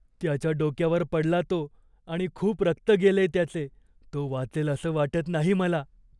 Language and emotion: Marathi, fearful